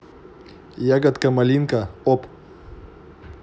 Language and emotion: Russian, positive